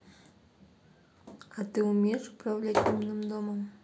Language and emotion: Russian, neutral